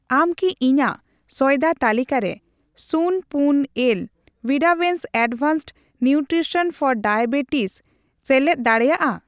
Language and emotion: Santali, neutral